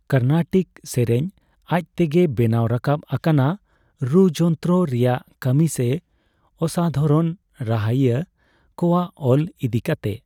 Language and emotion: Santali, neutral